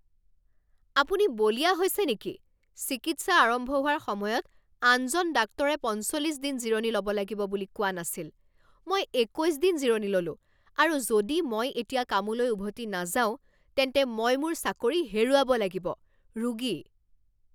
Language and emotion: Assamese, angry